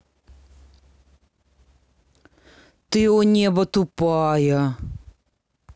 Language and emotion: Russian, angry